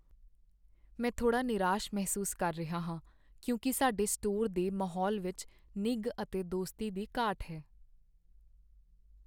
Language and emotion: Punjabi, sad